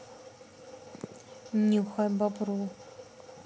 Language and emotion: Russian, neutral